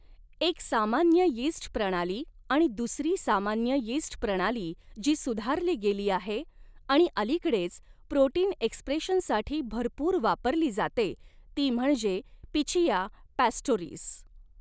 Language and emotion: Marathi, neutral